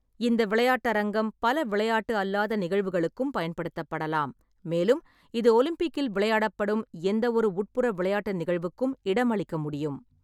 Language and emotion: Tamil, neutral